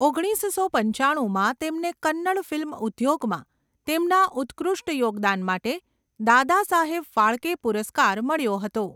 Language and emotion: Gujarati, neutral